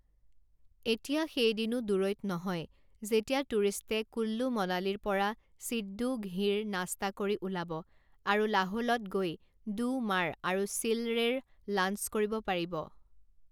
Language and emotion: Assamese, neutral